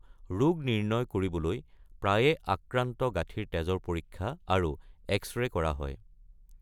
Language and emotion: Assamese, neutral